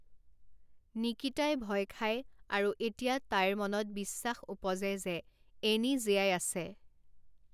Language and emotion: Assamese, neutral